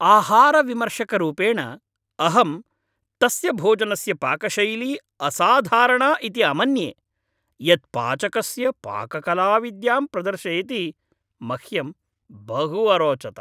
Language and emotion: Sanskrit, happy